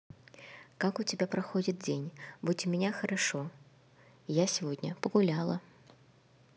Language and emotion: Russian, neutral